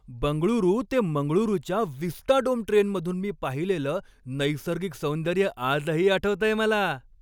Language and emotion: Marathi, happy